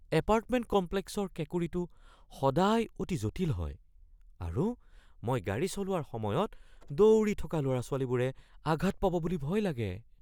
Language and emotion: Assamese, fearful